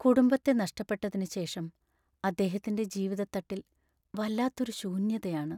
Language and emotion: Malayalam, sad